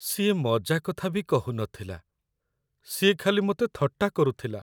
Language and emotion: Odia, sad